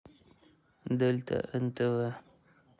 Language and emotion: Russian, neutral